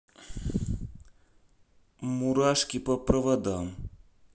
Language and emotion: Russian, neutral